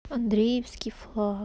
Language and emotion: Russian, sad